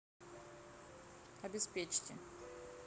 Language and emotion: Russian, neutral